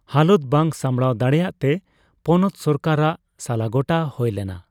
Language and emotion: Santali, neutral